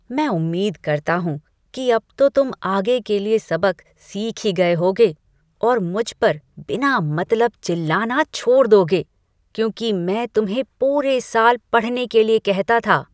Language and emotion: Hindi, disgusted